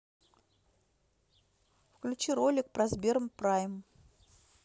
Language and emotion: Russian, neutral